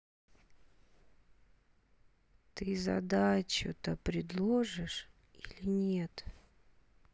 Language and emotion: Russian, angry